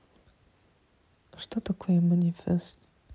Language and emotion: Russian, neutral